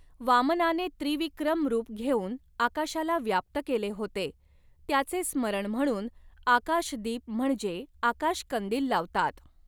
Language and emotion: Marathi, neutral